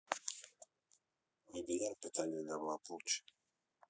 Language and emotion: Russian, neutral